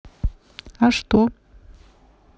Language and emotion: Russian, neutral